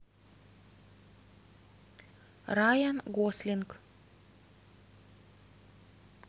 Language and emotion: Russian, neutral